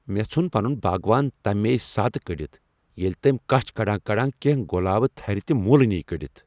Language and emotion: Kashmiri, angry